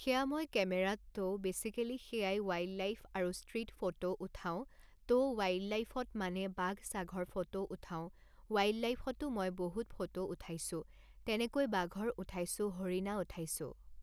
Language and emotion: Assamese, neutral